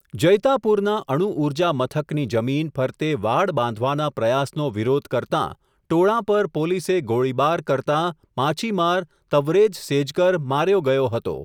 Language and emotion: Gujarati, neutral